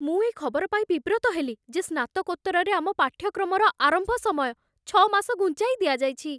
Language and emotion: Odia, fearful